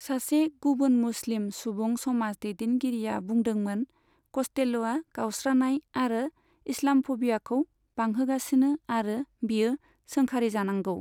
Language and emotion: Bodo, neutral